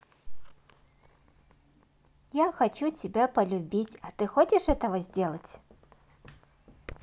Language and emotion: Russian, positive